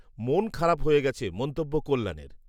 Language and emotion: Bengali, neutral